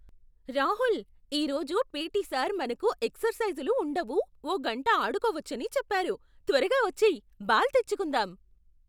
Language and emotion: Telugu, surprised